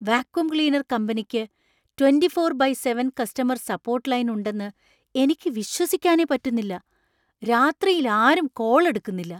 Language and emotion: Malayalam, surprised